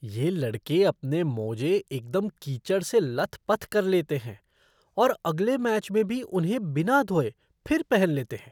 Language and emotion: Hindi, disgusted